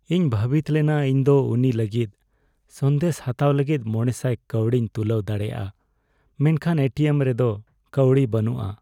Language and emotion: Santali, sad